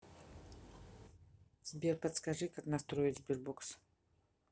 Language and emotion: Russian, neutral